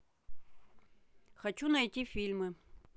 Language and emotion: Russian, neutral